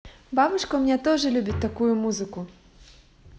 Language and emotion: Russian, positive